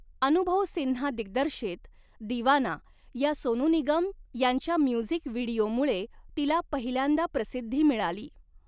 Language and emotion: Marathi, neutral